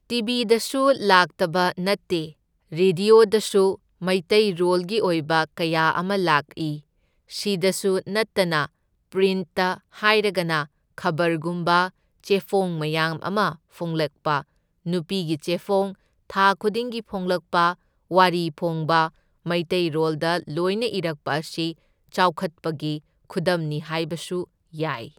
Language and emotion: Manipuri, neutral